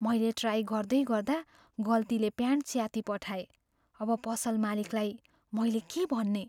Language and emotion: Nepali, fearful